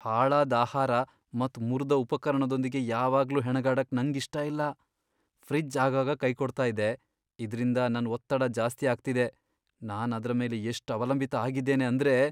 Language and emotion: Kannada, fearful